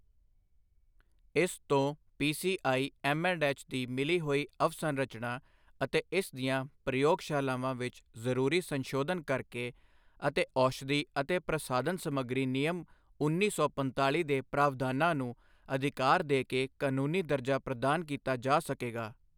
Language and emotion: Punjabi, neutral